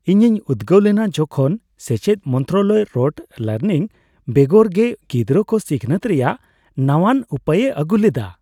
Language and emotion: Santali, happy